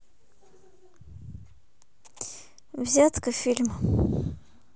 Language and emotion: Russian, neutral